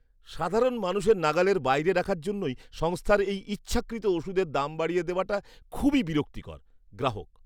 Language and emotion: Bengali, disgusted